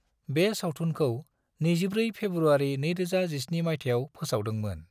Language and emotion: Bodo, neutral